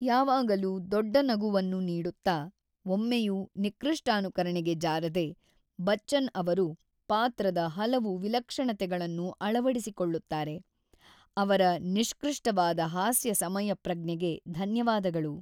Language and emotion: Kannada, neutral